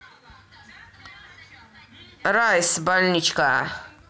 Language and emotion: Russian, positive